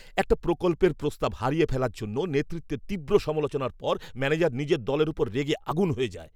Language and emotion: Bengali, angry